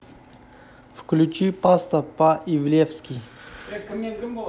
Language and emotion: Russian, neutral